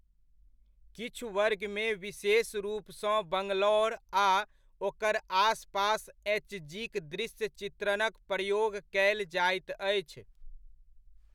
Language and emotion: Maithili, neutral